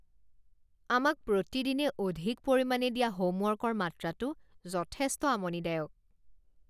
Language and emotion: Assamese, disgusted